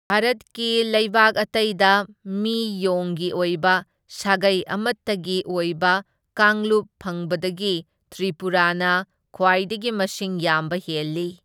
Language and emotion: Manipuri, neutral